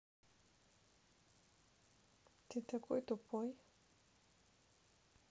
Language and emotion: Russian, neutral